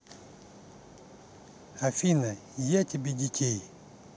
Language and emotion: Russian, neutral